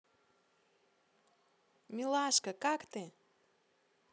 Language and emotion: Russian, positive